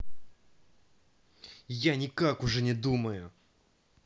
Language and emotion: Russian, angry